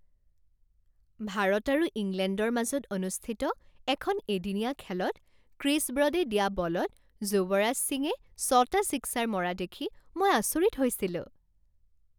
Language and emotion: Assamese, happy